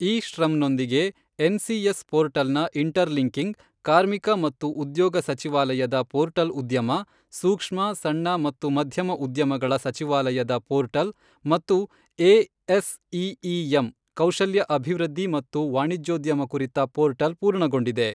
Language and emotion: Kannada, neutral